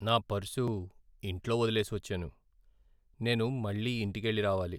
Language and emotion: Telugu, sad